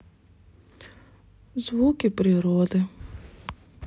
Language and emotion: Russian, sad